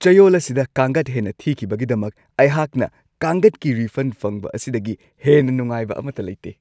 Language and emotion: Manipuri, happy